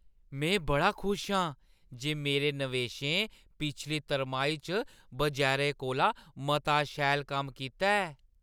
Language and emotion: Dogri, happy